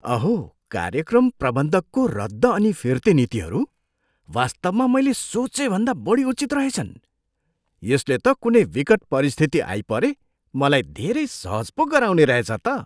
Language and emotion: Nepali, surprised